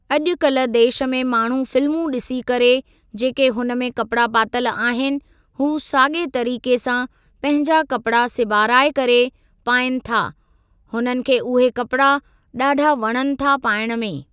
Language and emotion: Sindhi, neutral